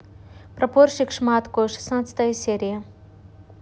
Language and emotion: Russian, neutral